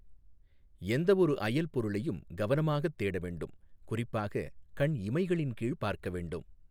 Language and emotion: Tamil, neutral